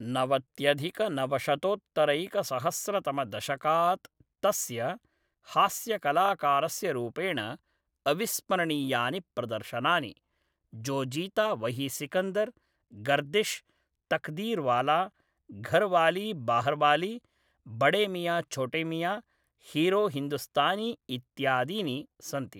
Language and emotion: Sanskrit, neutral